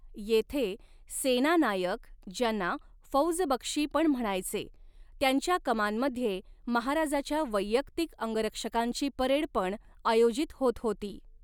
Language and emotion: Marathi, neutral